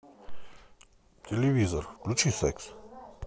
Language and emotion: Russian, neutral